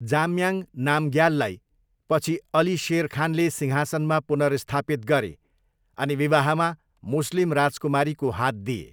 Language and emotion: Nepali, neutral